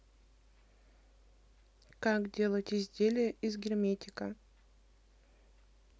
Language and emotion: Russian, neutral